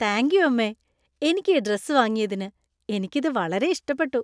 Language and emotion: Malayalam, happy